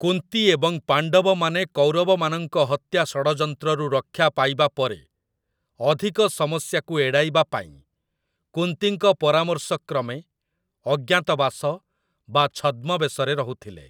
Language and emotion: Odia, neutral